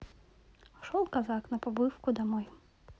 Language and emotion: Russian, neutral